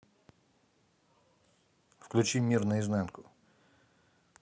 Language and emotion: Russian, neutral